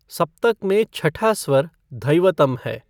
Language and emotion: Hindi, neutral